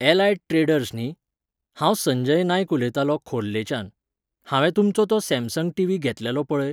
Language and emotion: Goan Konkani, neutral